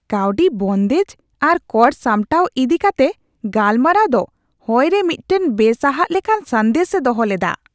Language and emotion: Santali, disgusted